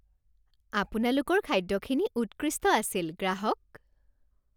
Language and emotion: Assamese, happy